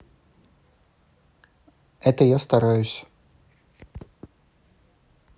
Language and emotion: Russian, neutral